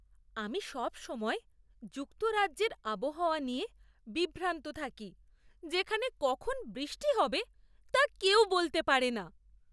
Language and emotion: Bengali, surprised